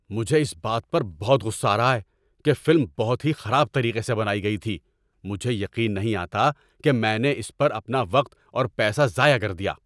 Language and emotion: Urdu, angry